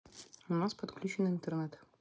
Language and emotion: Russian, neutral